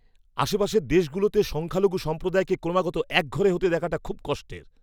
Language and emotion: Bengali, angry